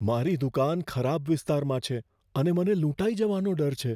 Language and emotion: Gujarati, fearful